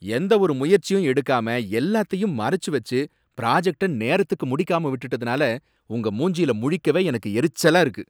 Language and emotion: Tamil, angry